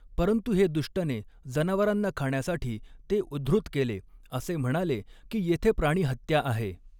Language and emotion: Marathi, neutral